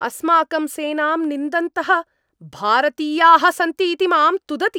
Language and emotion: Sanskrit, angry